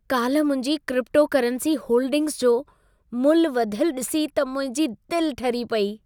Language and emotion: Sindhi, happy